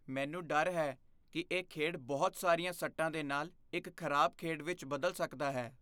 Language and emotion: Punjabi, fearful